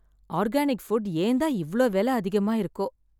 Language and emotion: Tamil, sad